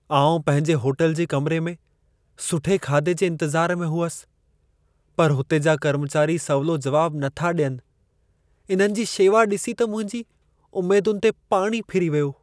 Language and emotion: Sindhi, sad